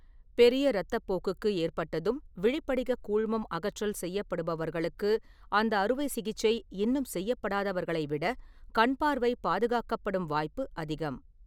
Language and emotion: Tamil, neutral